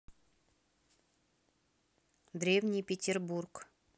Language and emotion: Russian, neutral